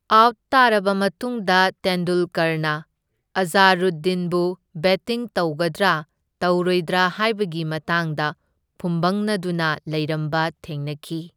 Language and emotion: Manipuri, neutral